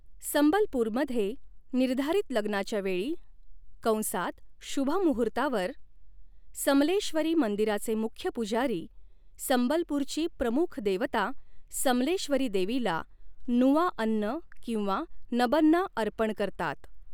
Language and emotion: Marathi, neutral